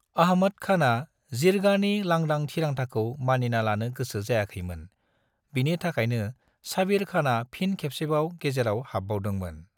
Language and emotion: Bodo, neutral